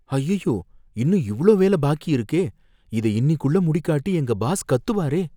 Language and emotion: Tamil, fearful